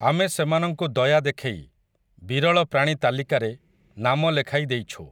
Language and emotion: Odia, neutral